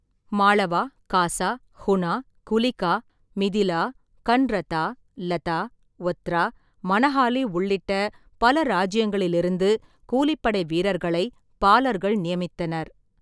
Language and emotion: Tamil, neutral